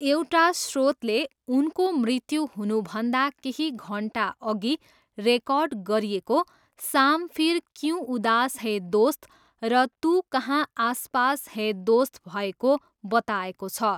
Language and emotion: Nepali, neutral